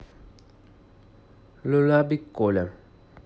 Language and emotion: Russian, neutral